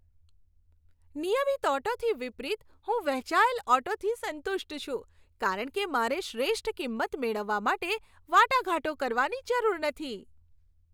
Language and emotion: Gujarati, happy